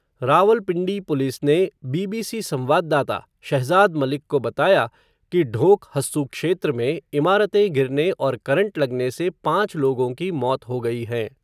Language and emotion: Hindi, neutral